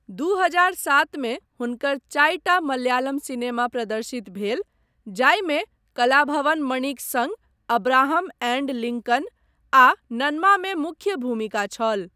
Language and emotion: Maithili, neutral